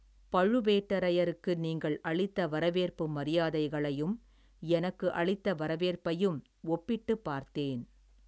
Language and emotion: Tamil, neutral